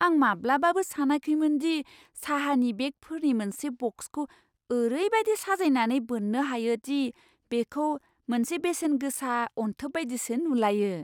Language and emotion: Bodo, surprised